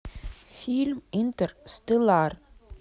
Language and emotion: Russian, neutral